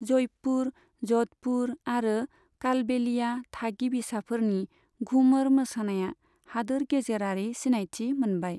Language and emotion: Bodo, neutral